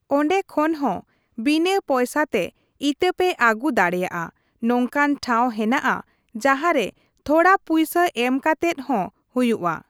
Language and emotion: Santali, neutral